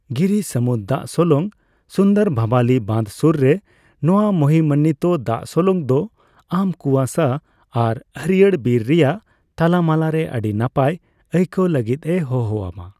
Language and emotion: Santali, neutral